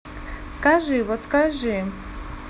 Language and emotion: Russian, neutral